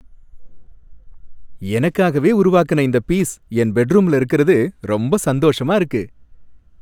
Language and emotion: Tamil, happy